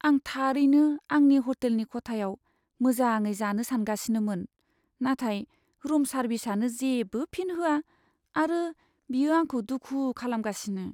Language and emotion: Bodo, sad